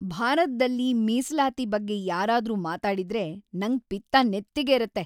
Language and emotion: Kannada, angry